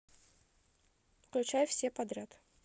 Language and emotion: Russian, neutral